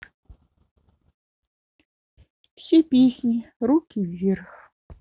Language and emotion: Russian, neutral